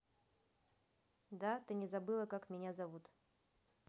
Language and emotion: Russian, neutral